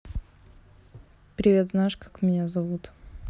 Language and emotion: Russian, neutral